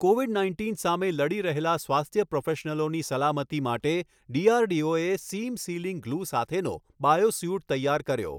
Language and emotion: Gujarati, neutral